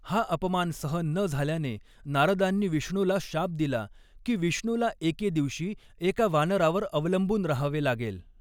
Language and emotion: Marathi, neutral